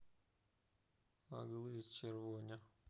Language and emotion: Russian, sad